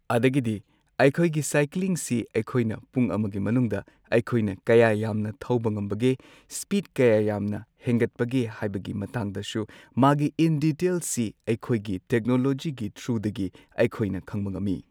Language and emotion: Manipuri, neutral